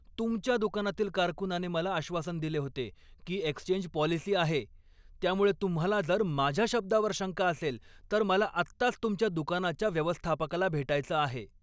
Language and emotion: Marathi, angry